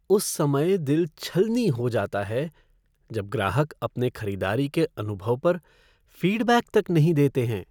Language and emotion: Hindi, sad